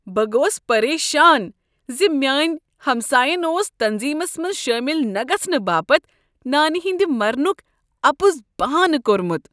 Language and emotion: Kashmiri, disgusted